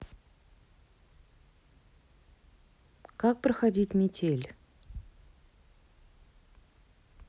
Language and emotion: Russian, neutral